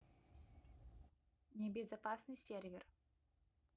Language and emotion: Russian, neutral